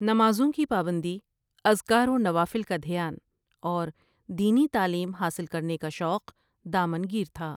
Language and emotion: Urdu, neutral